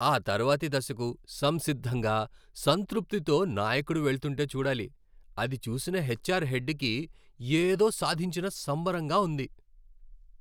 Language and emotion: Telugu, happy